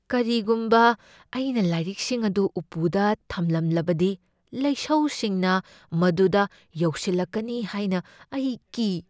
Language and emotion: Manipuri, fearful